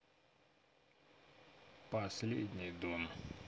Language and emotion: Russian, neutral